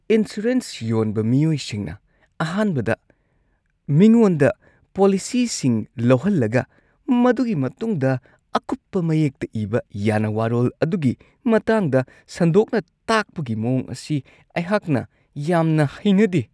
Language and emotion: Manipuri, disgusted